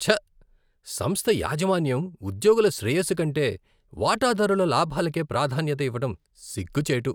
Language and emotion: Telugu, disgusted